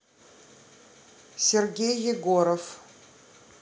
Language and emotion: Russian, neutral